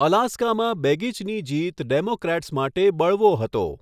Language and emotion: Gujarati, neutral